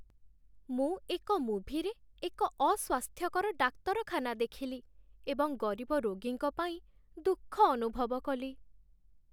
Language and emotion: Odia, sad